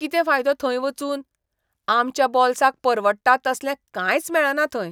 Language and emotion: Goan Konkani, disgusted